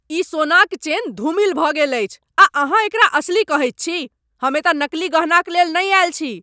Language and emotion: Maithili, angry